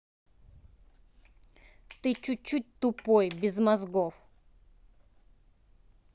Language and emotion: Russian, angry